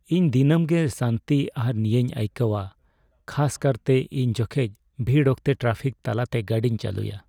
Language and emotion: Santali, sad